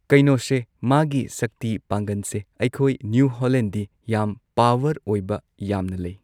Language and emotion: Manipuri, neutral